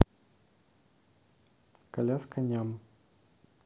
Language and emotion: Russian, neutral